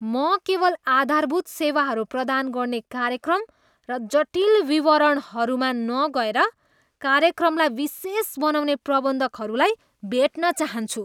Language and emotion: Nepali, disgusted